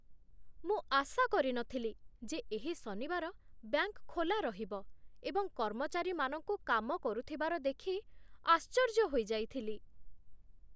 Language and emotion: Odia, surprised